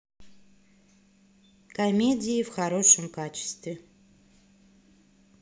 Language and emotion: Russian, neutral